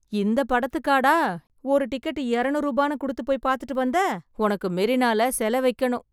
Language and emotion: Tamil, surprised